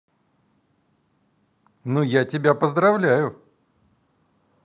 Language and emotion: Russian, positive